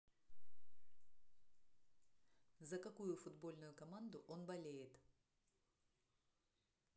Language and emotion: Russian, neutral